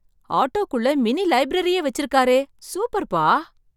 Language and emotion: Tamil, surprised